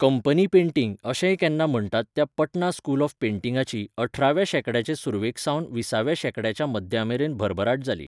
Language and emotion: Goan Konkani, neutral